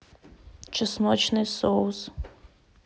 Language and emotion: Russian, neutral